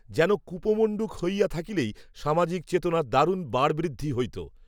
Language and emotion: Bengali, neutral